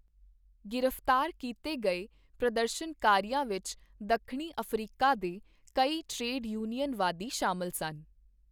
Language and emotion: Punjabi, neutral